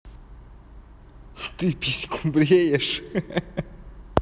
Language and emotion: Russian, positive